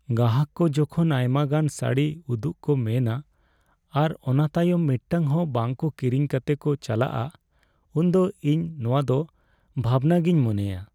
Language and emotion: Santali, sad